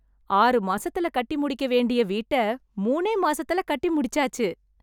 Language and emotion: Tamil, happy